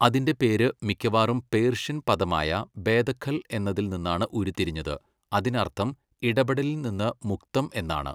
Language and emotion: Malayalam, neutral